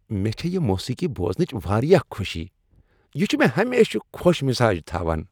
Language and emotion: Kashmiri, happy